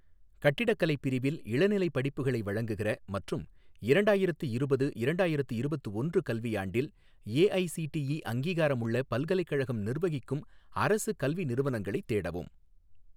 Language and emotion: Tamil, neutral